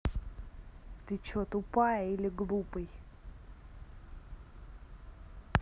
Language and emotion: Russian, angry